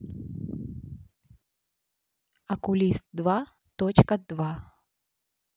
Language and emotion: Russian, neutral